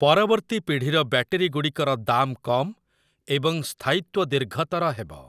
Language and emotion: Odia, neutral